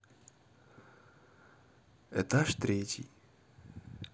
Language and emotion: Russian, neutral